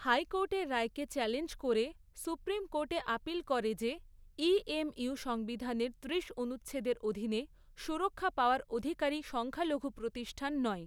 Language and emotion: Bengali, neutral